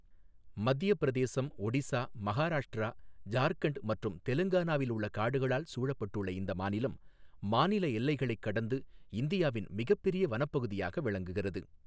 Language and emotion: Tamil, neutral